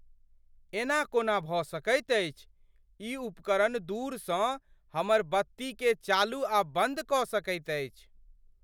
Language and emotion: Maithili, surprised